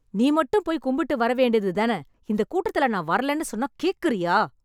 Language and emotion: Tamil, angry